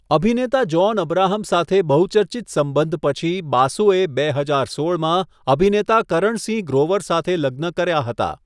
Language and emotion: Gujarati, neutral